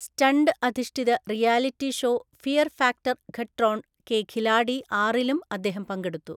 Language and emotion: Malayalam, neutral